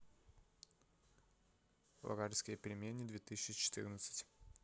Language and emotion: Russian, neutral